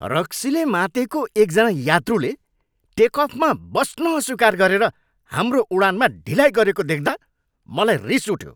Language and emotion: Nepali, angry